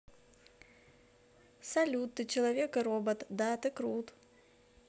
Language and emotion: Russian, positive